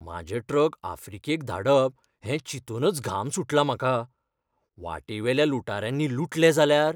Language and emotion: Goan Konkani, fearful